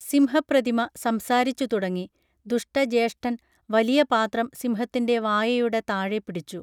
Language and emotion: Malayalam, neutral